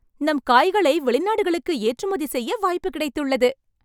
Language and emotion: Tamil, happy